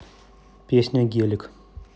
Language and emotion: Russian, neutral